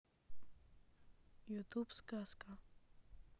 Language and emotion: Russian, neutral